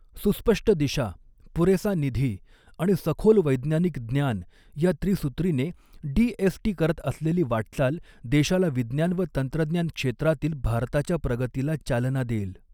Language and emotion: Marathi, neutral